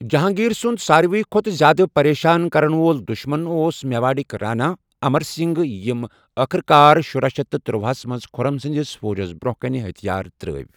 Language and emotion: Kashmiri, neutral